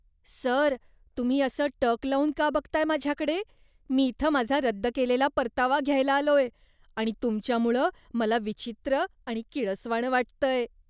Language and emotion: Marathi, disgusted